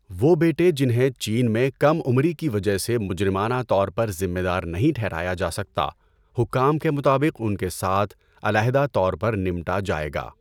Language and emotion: Urdu, neutral